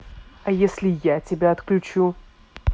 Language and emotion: Russian, angry